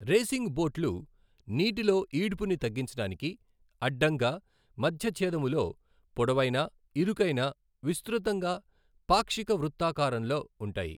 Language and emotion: Telugu, neutral